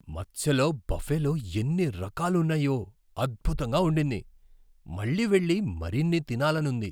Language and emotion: Telugu, surprised